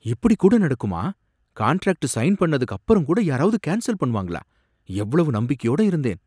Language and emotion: Tamil, surprised